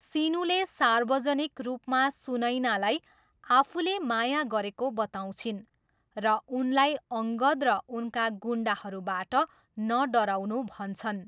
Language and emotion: Nepali, neutral